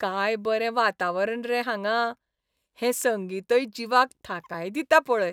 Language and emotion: Goan Konkani, happy